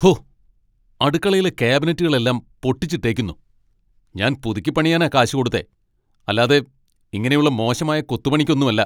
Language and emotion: Malayalam, angry